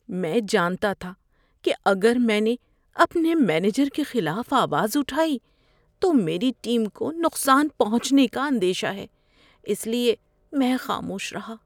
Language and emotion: Urdu, fearful